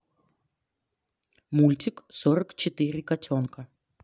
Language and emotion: Russian, neutral